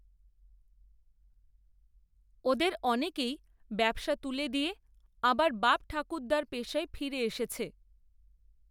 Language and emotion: Bengali, neutral